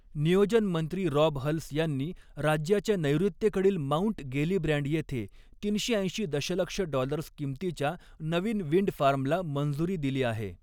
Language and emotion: Marathi, neutral